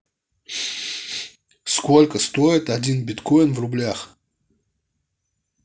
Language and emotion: Russian, neutral